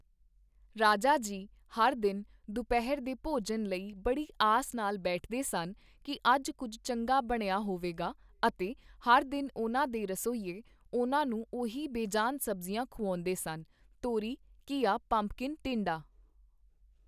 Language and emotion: Punjabi, neutral